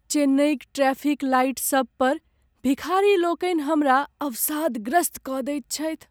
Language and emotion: Maithili, sad